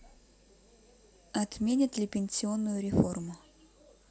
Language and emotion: Russian, neutral